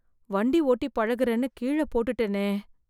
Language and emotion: Tamil, fearful